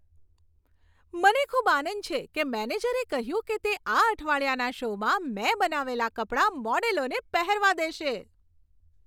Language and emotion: Gujarati, happy